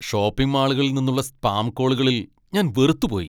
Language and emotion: Malayalam, angry